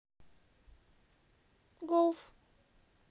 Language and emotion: Russian, sad